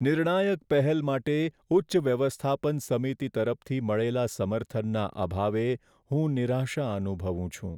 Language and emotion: Gujarati, sad